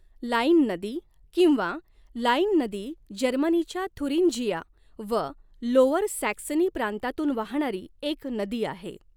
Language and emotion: Marathi, neutral